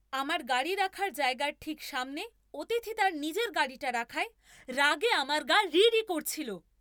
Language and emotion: Bengali, angry